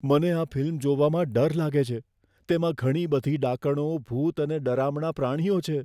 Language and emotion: Gujarati, fearful